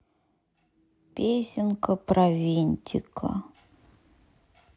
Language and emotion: Russian, sad